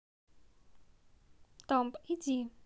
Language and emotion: Russian, neutral